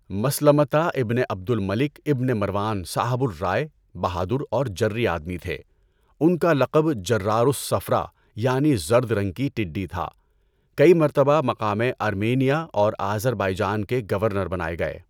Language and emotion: Urdu, neutral